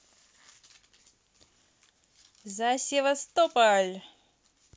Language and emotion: Russian, positive